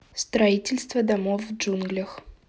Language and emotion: Russian, neutral